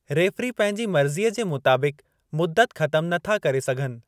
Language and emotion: Sindhi, neutral